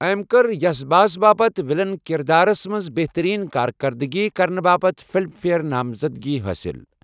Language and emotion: Kashmiri, neutral